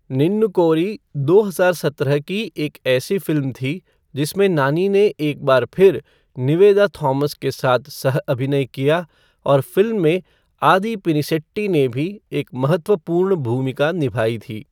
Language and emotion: Hindi, neutral